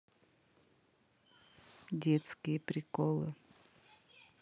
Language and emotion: Russian, neutral